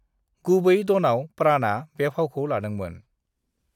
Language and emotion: Bodo, neutral